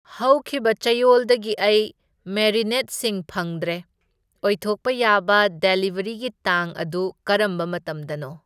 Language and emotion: Manipuri, neutral